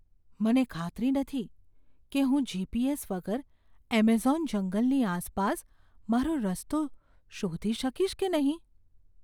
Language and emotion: Gujarati, fearful